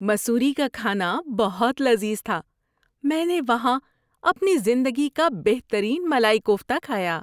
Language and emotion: Urdu, happy